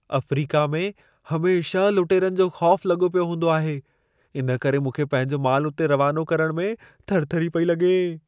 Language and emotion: Sindhi, fearful